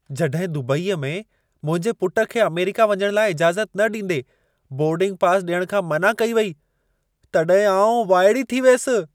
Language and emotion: Sindhi, surprised